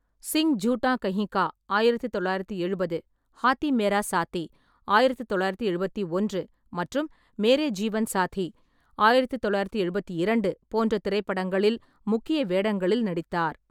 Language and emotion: Tamil, neutral